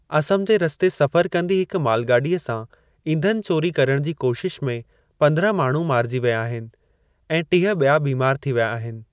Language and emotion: Sindhi, neutral